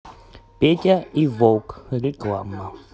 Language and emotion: Russian, neutral